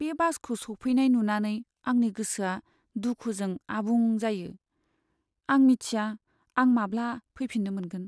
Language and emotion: Bodo, sad